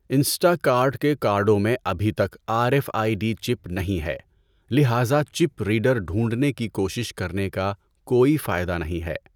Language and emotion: Urdu, neutral